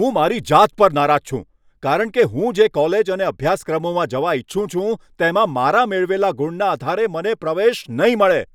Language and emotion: Gujarati, angry